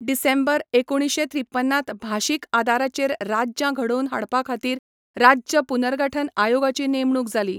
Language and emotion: Goan Konkani, neutral